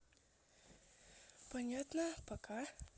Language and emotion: Russian, neutral